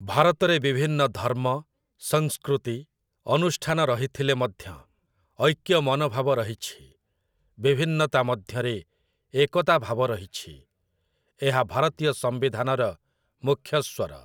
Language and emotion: Odia, neutral